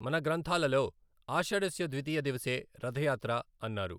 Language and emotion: Telugu, neutral